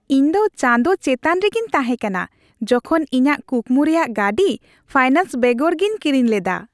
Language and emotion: Santali, happy